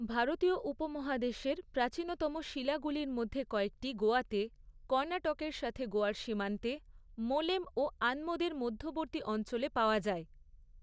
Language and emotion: Bengali, neutral